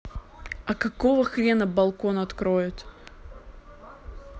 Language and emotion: Russian, neutral